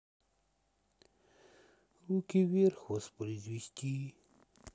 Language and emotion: Russian, sad